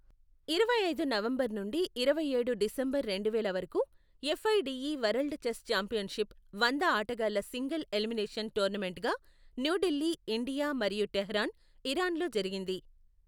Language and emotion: Telugu, neutral